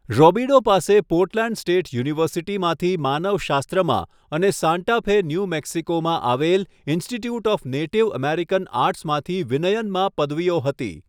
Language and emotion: Gujarati, neutral